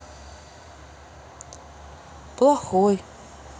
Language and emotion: Russian, sad